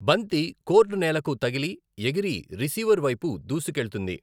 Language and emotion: Telugu, neutral